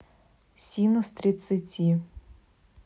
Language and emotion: Russian, neutral